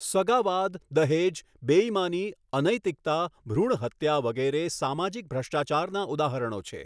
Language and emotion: Gujarati, neutral